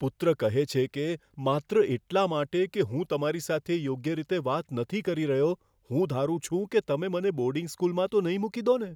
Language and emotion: Gujarati, fearful